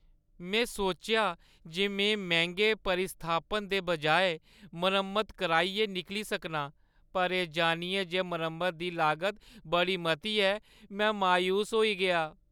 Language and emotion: Dogri, sad